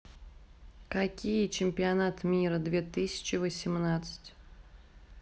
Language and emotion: Russian, neutral